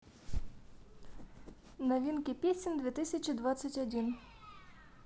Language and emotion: Russian, neutral